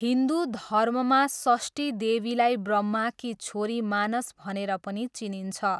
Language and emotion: Nepali, neutral